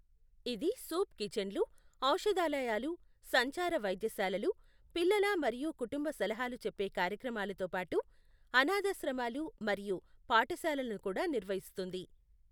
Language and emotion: Telugu, neutral